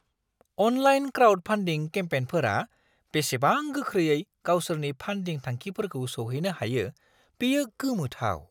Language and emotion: Bodo, surprised